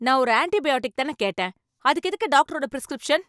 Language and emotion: Tamil, angry